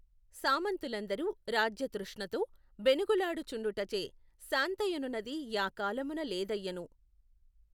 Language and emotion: Telugu, neutral